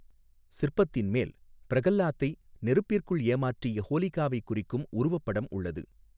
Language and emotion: Tamil, neutral